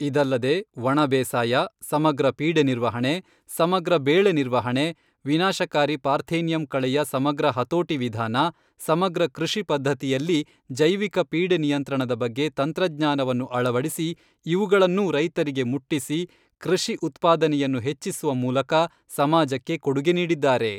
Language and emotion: Kannada, neutral